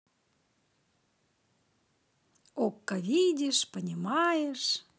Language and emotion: Russian, positive